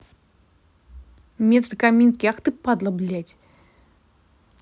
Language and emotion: Russian, angry